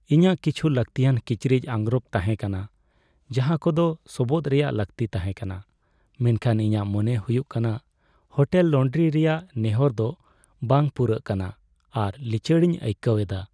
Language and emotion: Santali, sad